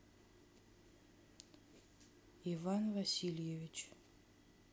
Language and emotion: Russian, neutral